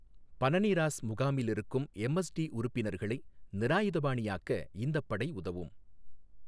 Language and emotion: Tamil, neutral